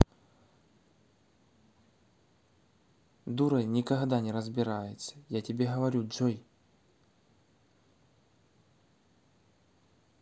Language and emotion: Russian, angry